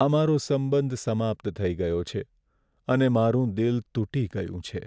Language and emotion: Gujarati, sad